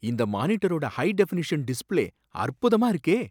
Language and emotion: Tamil, surprised